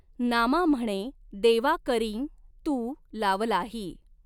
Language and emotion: Marathi, neutral